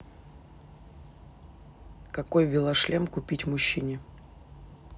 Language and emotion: Russian, neutral